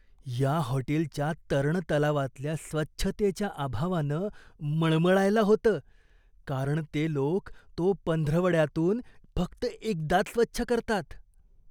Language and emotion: Marathi, disgusted